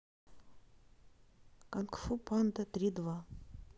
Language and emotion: Russian, neutral